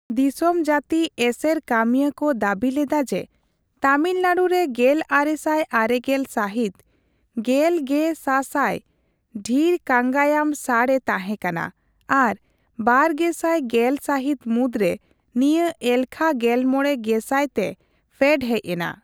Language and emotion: Santali, neutral